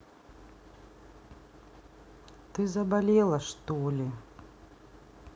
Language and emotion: Russian, neutral